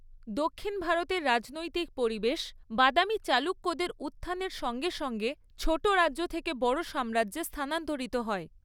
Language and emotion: Bengali, neutral